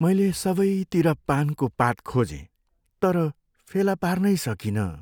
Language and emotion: Nepali, sad